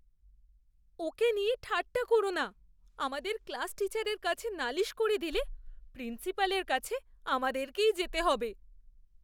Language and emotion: Bengali, fearful